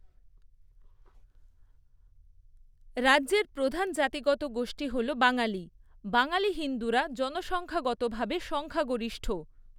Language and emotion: Bengali, neutral